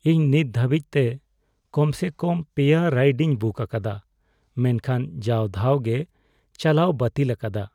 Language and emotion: Santali, sad